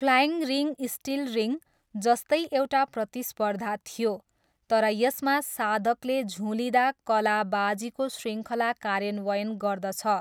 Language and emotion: Nepali, neutral